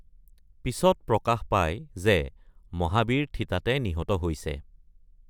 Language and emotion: Assamese, neutral